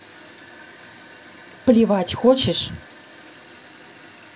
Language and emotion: Russian, neutral